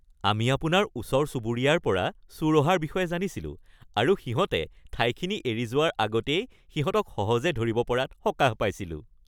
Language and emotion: Assamese, happy